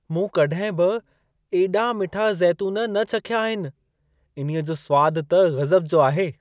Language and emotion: Sindhi, surprised